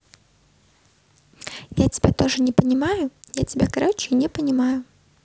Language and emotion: Russian, neutral